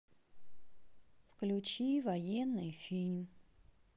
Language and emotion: Russian, sad